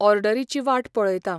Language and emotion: Goan Konkani, neutral